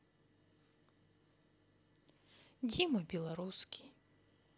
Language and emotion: Russian, neutral